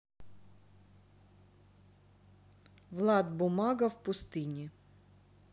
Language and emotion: Russian, neutral